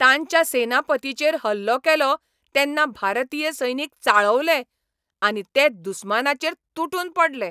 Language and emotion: Goan Konkani, angry